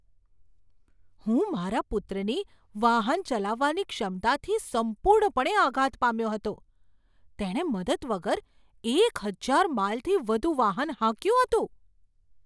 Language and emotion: Gujarati, surprised